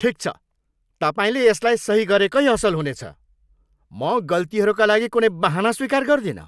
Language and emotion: Nepali, angry